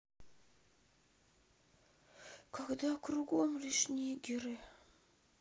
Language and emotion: Russian, sad